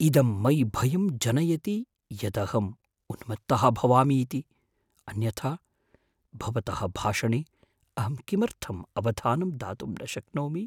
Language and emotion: Sanskrit, fearful